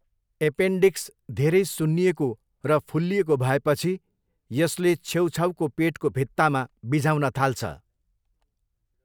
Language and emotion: Nepali, neutral